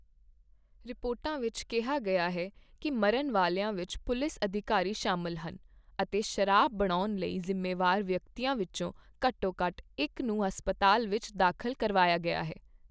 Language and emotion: Punjabi, neutral